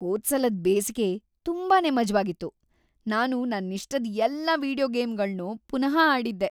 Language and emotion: Kannada, happy